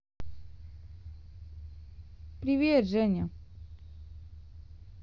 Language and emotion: Russian, neutral